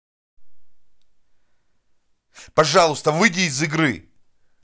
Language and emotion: Russian, angry